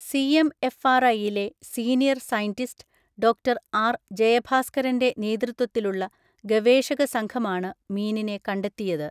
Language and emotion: Malayalam, neutral